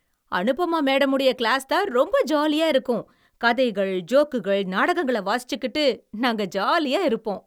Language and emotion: Tamil, happy